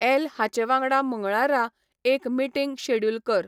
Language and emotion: Goan Konkani, neutral